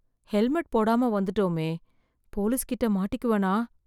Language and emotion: Tamil, fearful